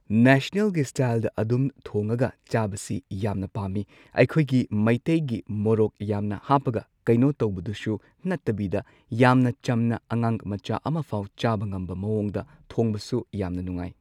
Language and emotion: Manipuri, neutral